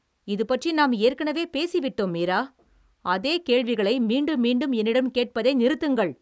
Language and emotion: Tamil, angry